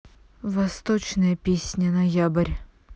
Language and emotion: Russian, neutral